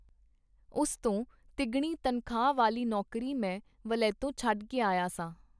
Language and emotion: Punjabi, neutral